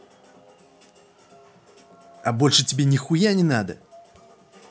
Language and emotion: Russian, angry